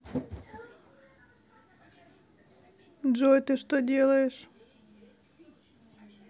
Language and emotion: Russian, neutral